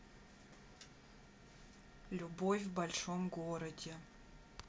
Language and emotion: Russian, sad